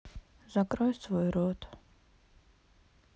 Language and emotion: Russian, sad